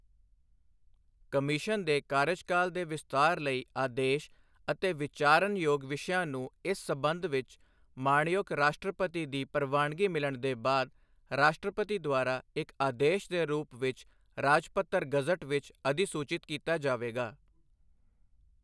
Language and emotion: Punjabi, neutral